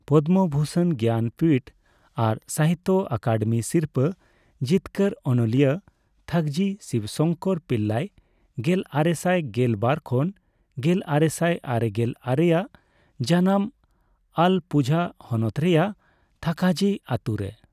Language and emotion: Santali, neutral